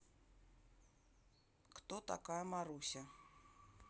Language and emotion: Russian, neutral